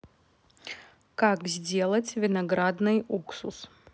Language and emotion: Russian, neutral